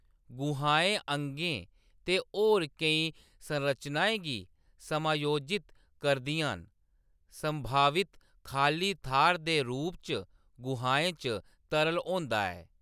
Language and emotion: Dogri, neutral